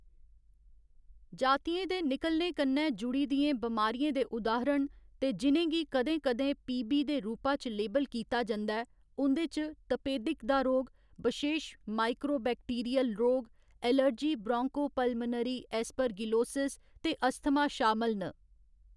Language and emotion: Dogri, neutral